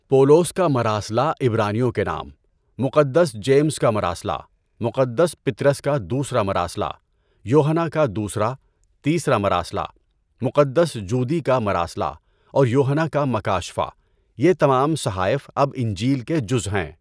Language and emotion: Urdu, neutral